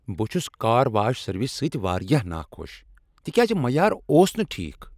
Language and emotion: Kashmiri, angry